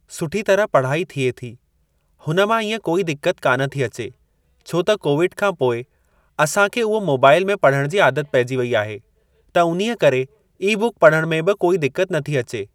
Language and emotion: Sindhi, neutral